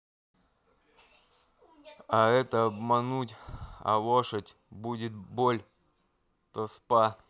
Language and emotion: Russian, neutral